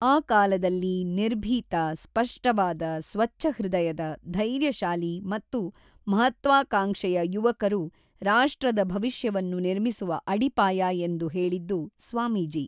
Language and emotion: Kannada, neutral